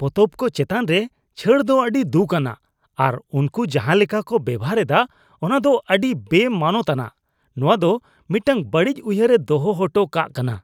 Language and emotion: Santali, disgusted